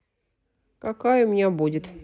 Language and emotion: Russian, neutral